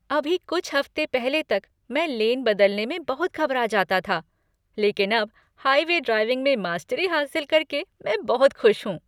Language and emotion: Hindi, happy